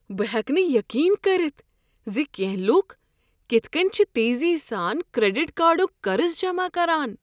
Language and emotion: Kashmiri, surprised